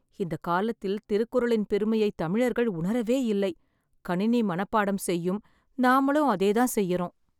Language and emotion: Tamil, sad